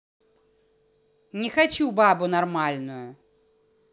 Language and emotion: Russian, angry